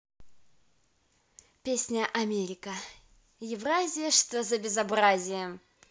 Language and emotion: Russian, positive